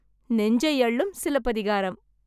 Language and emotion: Tamil, happy